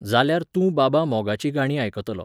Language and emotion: Goan Konkani, neutral